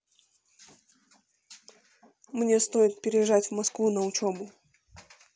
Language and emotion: Russian, neutral